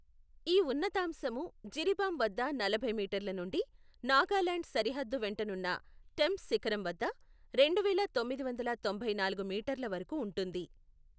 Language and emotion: Telugu, neutral